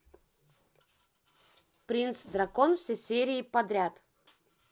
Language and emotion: Russian, positive